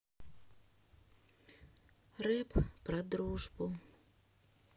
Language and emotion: Russian, sad